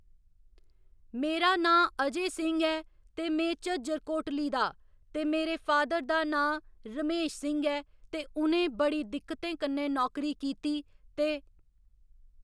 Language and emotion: Dogri, neutral